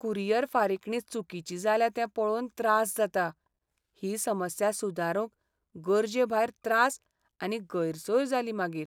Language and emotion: Goan Konkani, sad